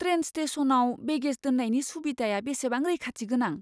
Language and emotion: Bodo, fearful